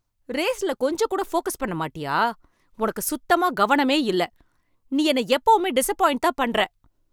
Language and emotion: Tamil, angry